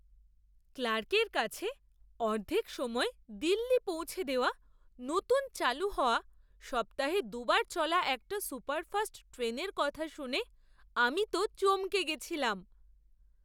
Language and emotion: Bengali, surprised